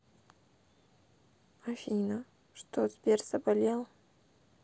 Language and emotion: Russian, sad